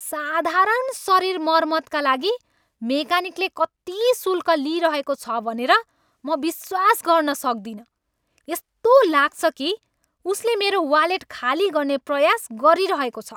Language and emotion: Nepali, angry